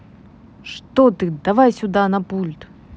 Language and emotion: Russian, neutral